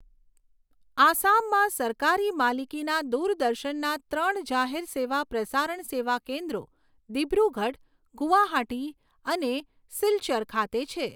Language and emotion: Gujarati, neutral